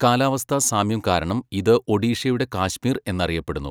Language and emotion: Malayalam, neutral